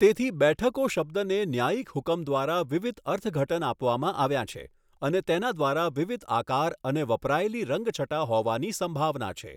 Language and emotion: Gujarati, neutral